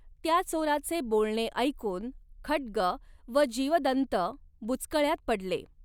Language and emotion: Marathi, neutral